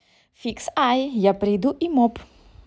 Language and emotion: Russian, positive